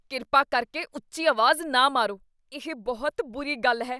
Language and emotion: Punjabi, disgusted